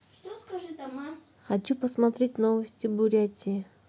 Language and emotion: Russian, neutral